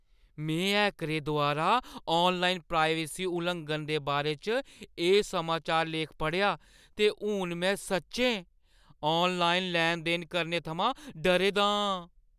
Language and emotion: Dogri, fearful